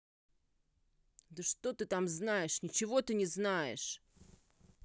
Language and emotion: Russian, angry